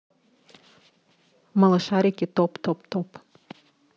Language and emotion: Russian, neutral